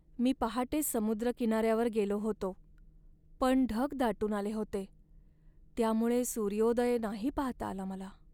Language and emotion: Marathi, sad